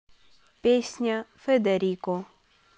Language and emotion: Russian, neutral